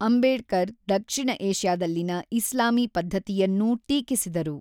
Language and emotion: Kannada, neutral